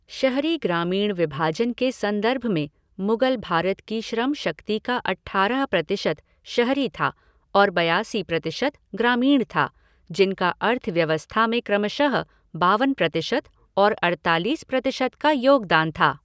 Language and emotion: Hindi, neutral